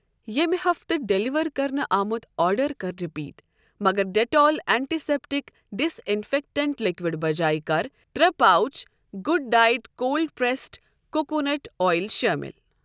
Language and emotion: Kashmiri, neutral